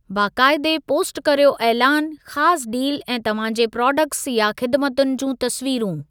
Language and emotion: Sindhi, neutral